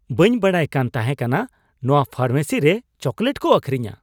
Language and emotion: Santali, surprised